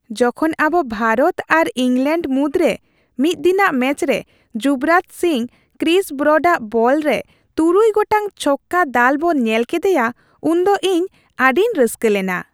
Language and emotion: Santali, happy